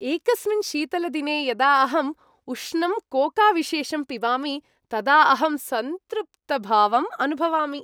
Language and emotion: Sanskrit, happy